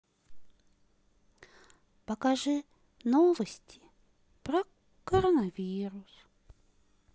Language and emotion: Russian, sad